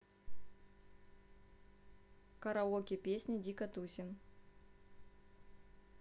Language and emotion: Russian, neutral